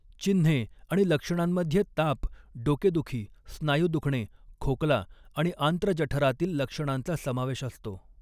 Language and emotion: Marathi, neutral